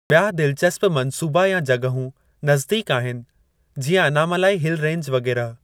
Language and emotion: Sindhi, neutral